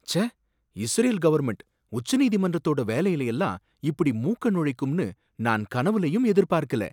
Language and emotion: Tamil, surprised